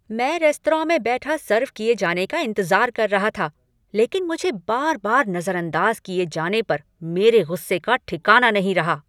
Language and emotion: Hindi, angry